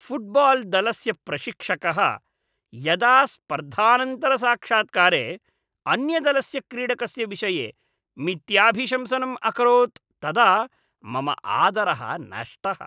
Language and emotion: Sanskrit, disgusted